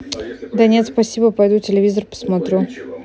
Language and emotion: Russian, neutral